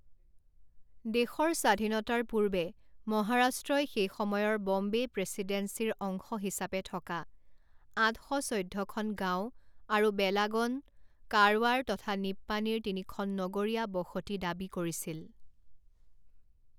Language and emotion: Assamese, neutral